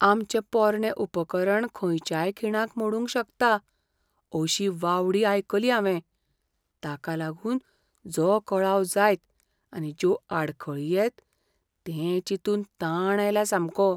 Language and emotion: Goan Konkani, fearful